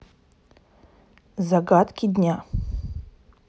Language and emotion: Russian, neutral